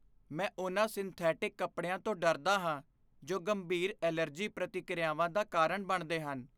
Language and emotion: Punjabi, fearful